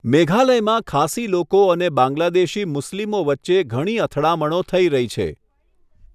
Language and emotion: Gujarati, neutral